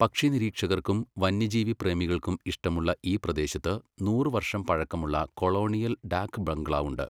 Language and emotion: Malayalam, neutral